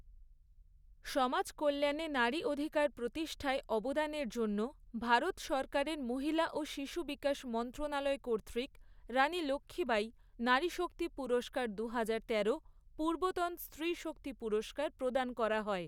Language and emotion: Bengali, neutral